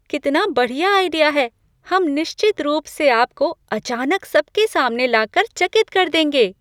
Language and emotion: Hindi, surprised